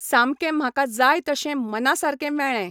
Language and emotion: Goan Konkani, neutral